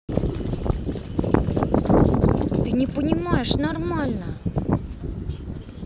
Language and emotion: Russian, angry